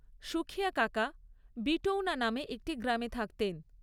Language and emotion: Bengali, neutral